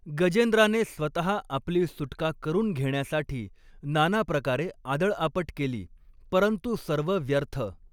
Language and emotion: Marathi, neutral